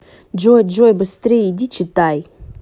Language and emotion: Russian, angry